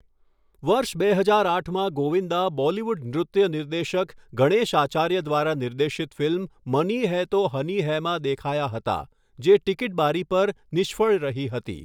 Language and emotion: Gujarati, neutral